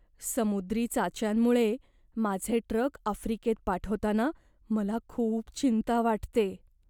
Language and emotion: Marathi, fearful